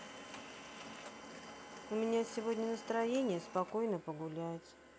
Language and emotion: Russian, sad